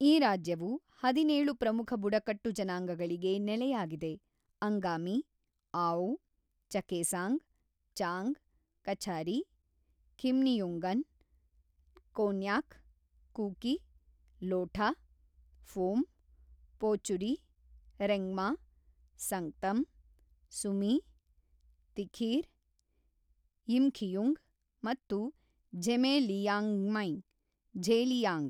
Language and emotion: Kannada, neutral